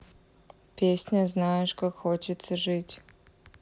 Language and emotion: Russian, neutral